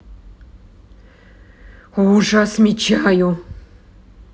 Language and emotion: Russian, angry